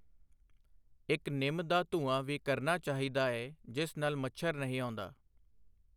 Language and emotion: Punjabi, neutral